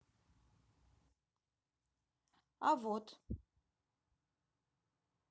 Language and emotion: Russian, neutral